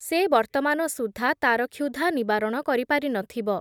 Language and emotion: Odia, neutral